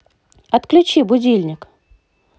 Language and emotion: Russian, positive